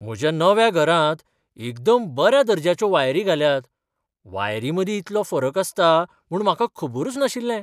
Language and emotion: Goan Konkani, surprised